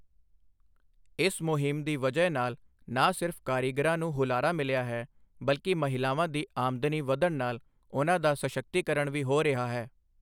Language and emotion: Punjabi, neutral